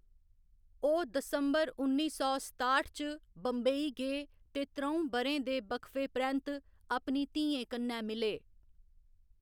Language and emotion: Dogri, neutral